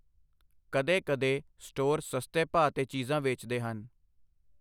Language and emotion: Punjabi, neutral